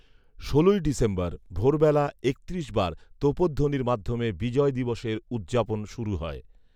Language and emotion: Bengali, neutral